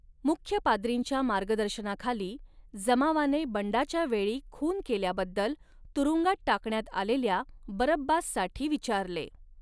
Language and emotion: Marathi, neutral